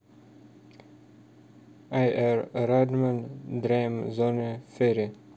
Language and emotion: Russian, neutral